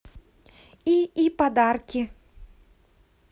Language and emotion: Russian, positive